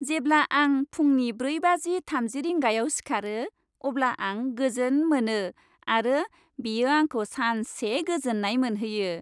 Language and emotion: Bodo, happy